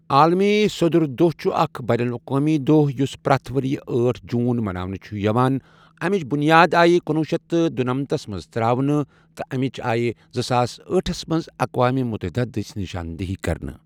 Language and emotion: Kashmiri, neutral